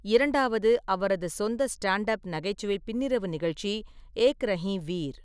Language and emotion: Tamil, neutral